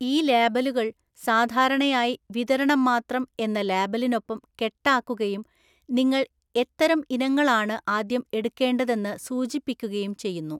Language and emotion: Malayalam, neutral